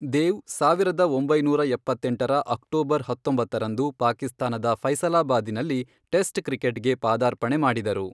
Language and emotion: Kannada, neutral